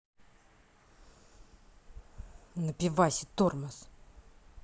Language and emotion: Russian, angry